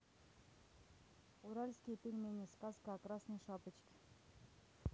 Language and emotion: Russian, neutral